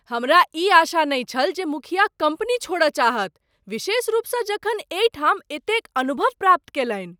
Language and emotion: Maithili, surprised